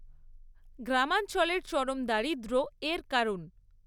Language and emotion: Bengali, neutral